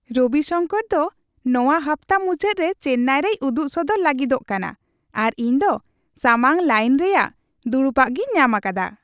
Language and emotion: Santali, happy